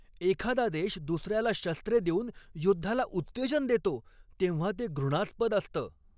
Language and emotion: Marathi, angry